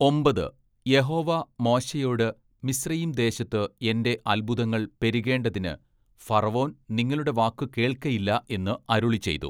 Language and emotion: Malayalam, neutral